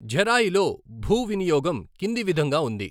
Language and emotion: Telugu, neutral